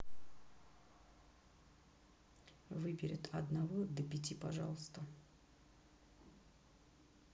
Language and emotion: Russian, neutral